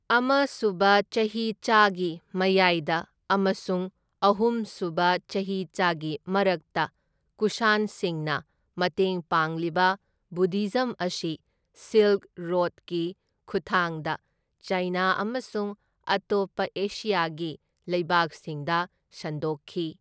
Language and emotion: Manipuri, neutral